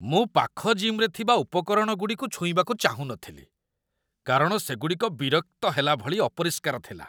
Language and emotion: Odia, disgusted